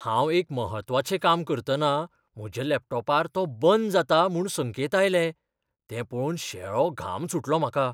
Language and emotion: Goan Konkani, fearful